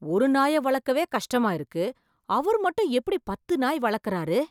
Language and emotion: Tamil, surprised